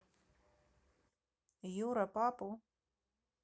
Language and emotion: Russian, neutral